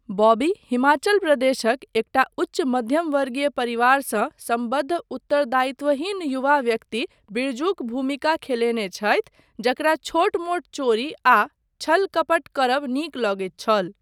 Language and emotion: Maithili, neutral